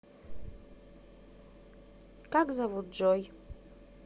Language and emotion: Russian, neutral